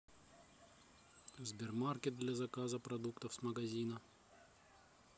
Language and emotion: Russian, neutral